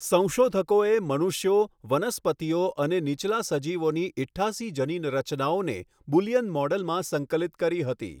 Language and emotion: Gujarati, neutral